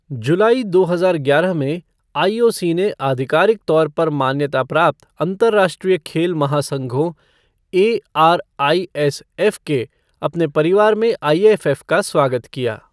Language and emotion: Hindi, neutral